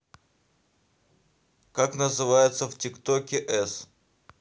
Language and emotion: Russian, neutral